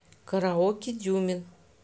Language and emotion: Russian, neutral